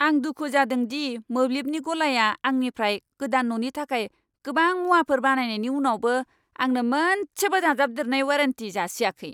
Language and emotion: Bodo, angry